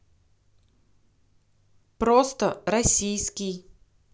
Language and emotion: Russian, neutral